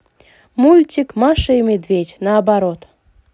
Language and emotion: Russian, positive